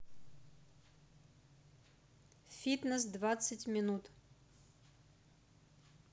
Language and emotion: Russian, neutral